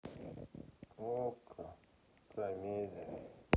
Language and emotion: Russian, sad